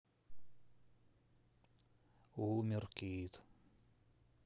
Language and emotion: Russian, sad